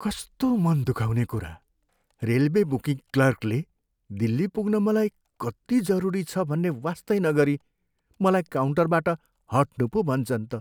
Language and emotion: Nepali, sad